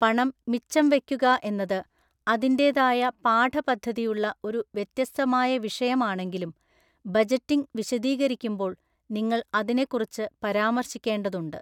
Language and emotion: Malayalam, neutral